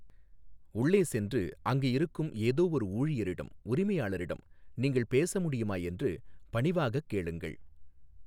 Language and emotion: Tamil, neutral